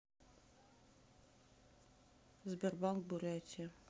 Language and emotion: Russian, neutral